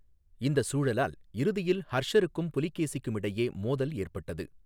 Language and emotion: Tamil, neutral